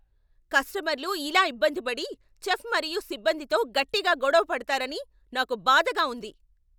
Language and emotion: Telugu, angry